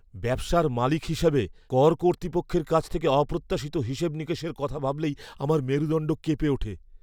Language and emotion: Bengali, fearful